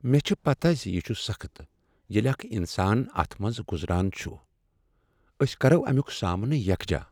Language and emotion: Kashmiri, sad